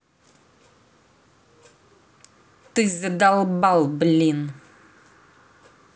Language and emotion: Russian, angry